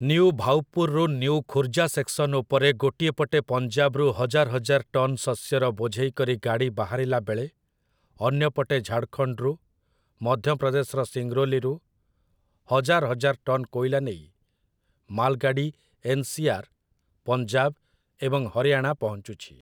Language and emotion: Odia, neutral